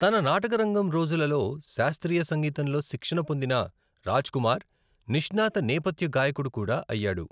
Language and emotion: Telugu, neutral